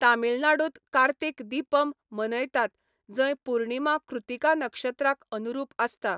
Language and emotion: Goan Konkani, neutral